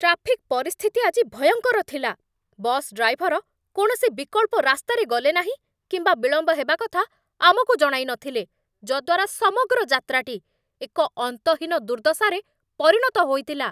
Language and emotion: Odia, angry